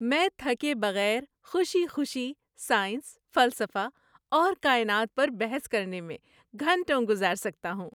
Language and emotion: Urdu, happy